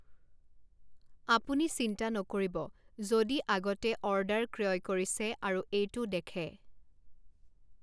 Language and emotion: Assamese, neutral